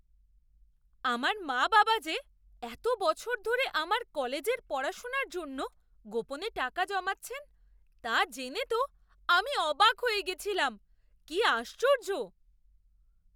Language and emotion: Bengali, surprised